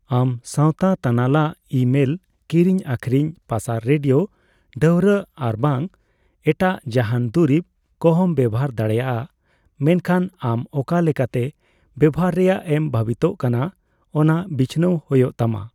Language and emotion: Santali, neutral